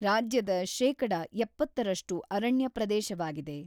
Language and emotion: Kannada, neutral